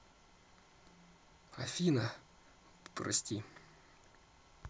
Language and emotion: Russian, sad